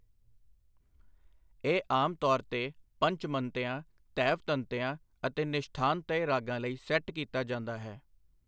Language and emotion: Punjabi, neutral